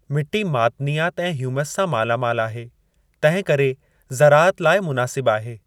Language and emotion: Sindhi, neutral